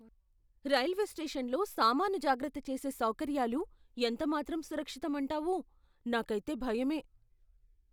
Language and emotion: Telugu, fearful